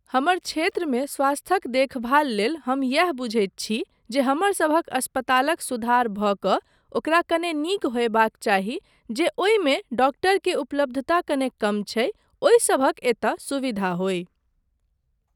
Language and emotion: Maithili, neutral